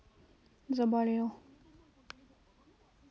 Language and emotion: Russian, neutral